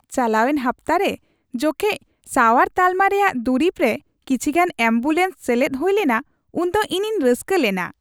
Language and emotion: Santali, happy